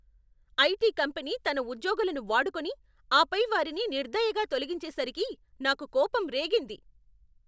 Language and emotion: Telugu, angry